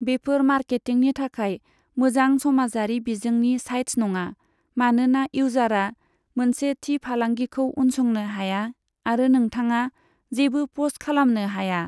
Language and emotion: Bodo, neutral